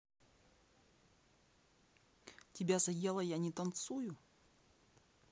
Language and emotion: Russian, neutral